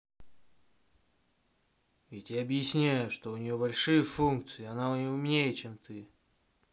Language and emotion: Russian, angry